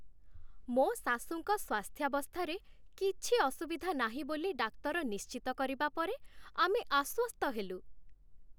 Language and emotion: Odia, happy